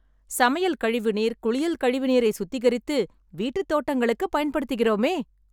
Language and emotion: Tamil, happy